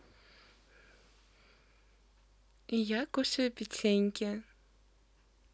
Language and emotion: Russian, positive